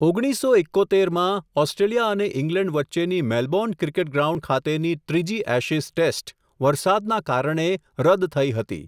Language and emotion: Gujarati, neutral